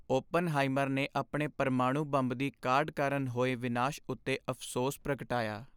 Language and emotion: Punjabi, sad